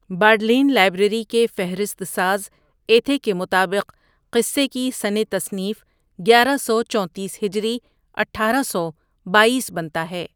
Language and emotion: Urdu, neutral